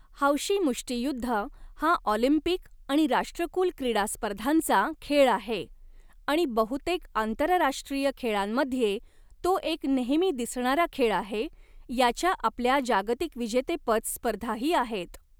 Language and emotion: Marathi, neutral